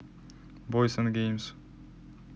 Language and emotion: Russian, neutral